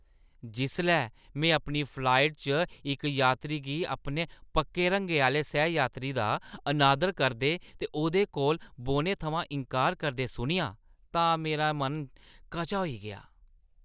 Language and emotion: Dogri, disgusted